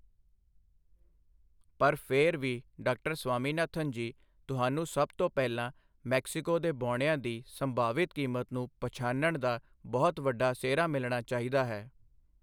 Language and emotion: Punjabi, neutral